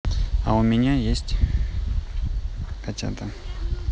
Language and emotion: Russian, neutral